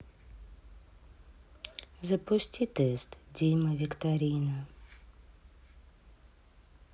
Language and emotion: Russian, sad